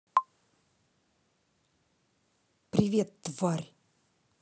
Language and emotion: Russian, angry